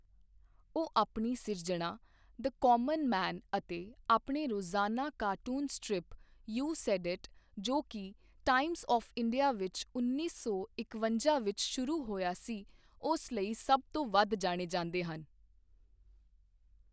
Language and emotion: Punjabi, neutral